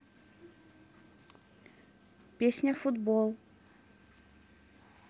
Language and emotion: Russian, neutral